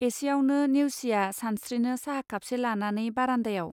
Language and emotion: Bodo, neutral